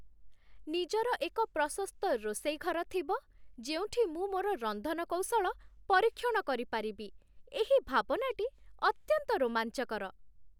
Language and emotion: Odia, happy